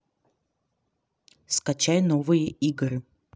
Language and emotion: Russian, neutral